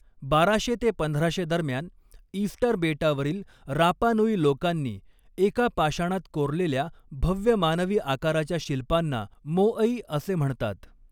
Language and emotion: Marathi, neutral